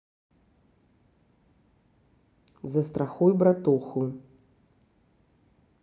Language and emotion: Russian, neutral